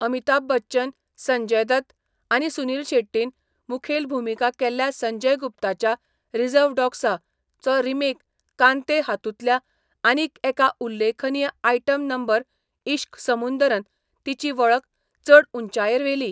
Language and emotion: Goan Konkani, neutral